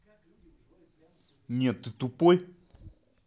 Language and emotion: Russian, angry